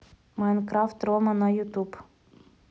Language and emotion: Russian, neutral